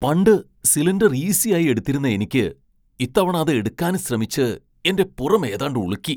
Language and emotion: Malayalam, surprised